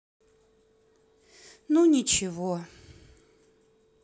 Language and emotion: Russian, sad